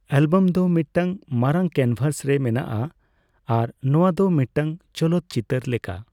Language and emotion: Santali, neutral